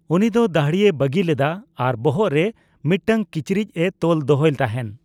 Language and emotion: Santali, neutral